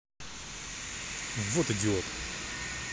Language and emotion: Russian, angry